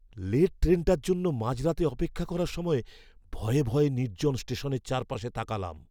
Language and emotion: Bengali, fearful